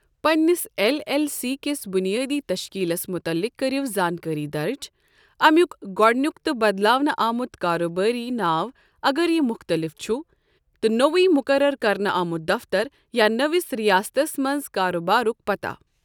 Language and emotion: Kashmiri, neutral